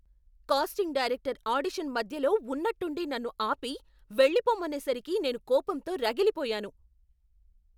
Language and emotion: Telugu, angry